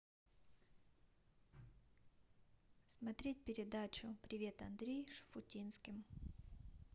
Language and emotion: Russian, neutral